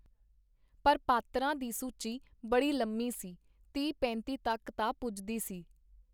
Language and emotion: Punjabi, neutral